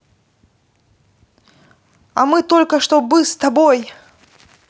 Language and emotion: Russian, neutral